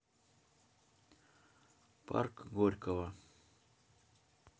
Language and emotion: Russian, neutral